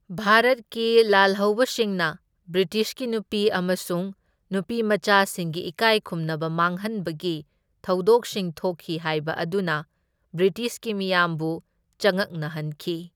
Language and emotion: Manipuri, neutral